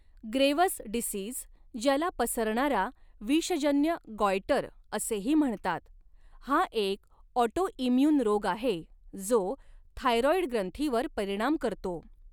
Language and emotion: Marathi, neutral